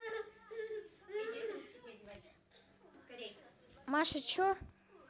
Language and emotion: Russian, neutral